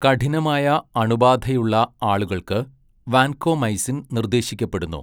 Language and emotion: Malayalam, neutral